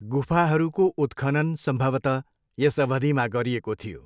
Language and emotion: Nepali, neutral